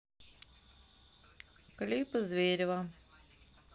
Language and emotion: Russian, neutral